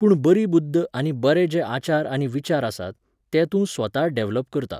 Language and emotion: Goan Konkani, neutral